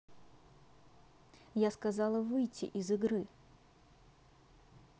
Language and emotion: Russian, angry